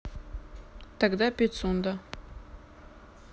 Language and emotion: Russian, neutral